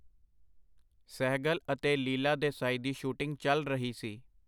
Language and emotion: Punjabi, neutral